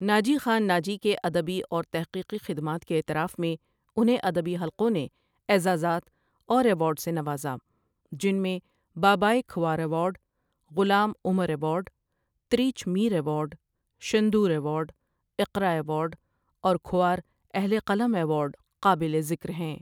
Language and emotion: Urdu, neutral